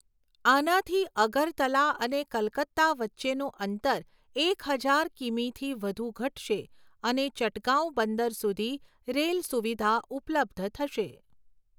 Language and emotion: Gujarati, neutral